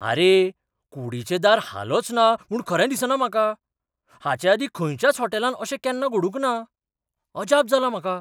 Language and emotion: Goan Konkani, surprised